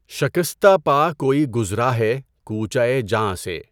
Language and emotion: Urdu, neutral